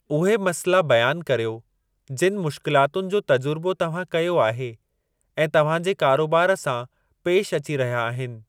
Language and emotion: Sindhi, neutral